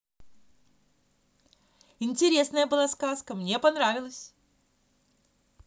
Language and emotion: Russian, positive